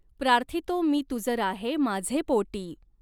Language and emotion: Marathi, neutral